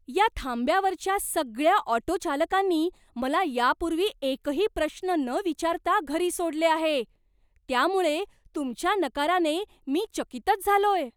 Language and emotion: Marathi, surprised